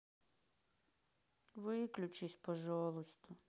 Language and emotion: Russian, sad